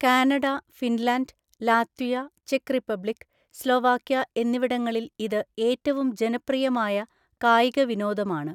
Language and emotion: Malayalam, neutral